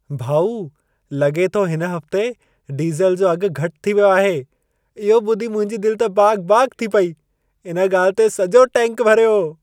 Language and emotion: Sindhi, happy